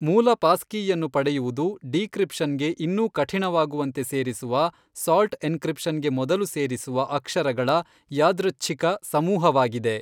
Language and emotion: Kannada, neutral